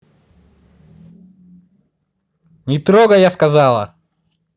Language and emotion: Russian, angry